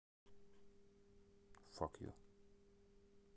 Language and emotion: Russian, neutral